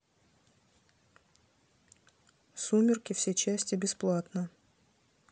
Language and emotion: Russian, neutral